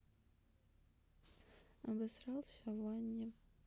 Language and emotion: Russian, sad